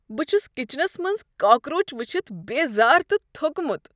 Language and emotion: Kashmiri, disgusted